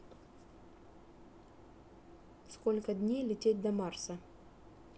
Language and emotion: Russian, neutral